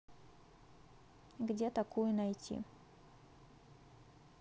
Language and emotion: Russian, neutral